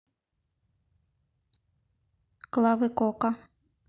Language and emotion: Russian, neutral